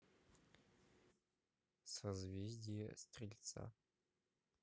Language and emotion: Russian, neutral